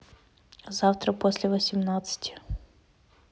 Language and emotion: Russian, neutral